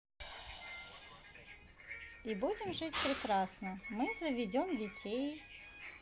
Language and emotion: Russian, positive